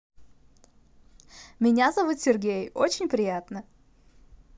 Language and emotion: Russian, positive